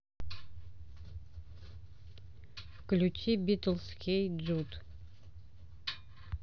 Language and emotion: Russian, neutral